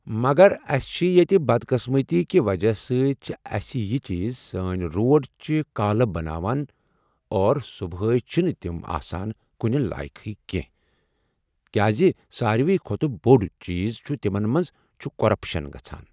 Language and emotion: Kashmiri, neutral